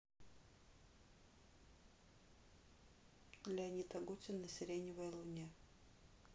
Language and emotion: Russian, neutral